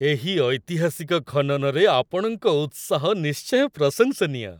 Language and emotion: Odia, happy